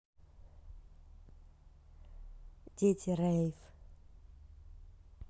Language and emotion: Russian, neutral